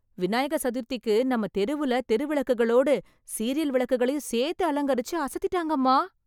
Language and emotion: Tamil, happy